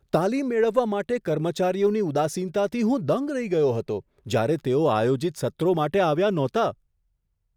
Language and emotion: Gujarati, surprised